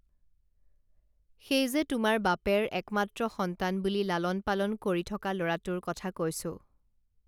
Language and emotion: Assamese, neutral